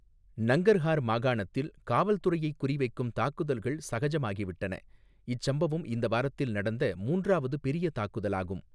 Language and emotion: Tamil, neutral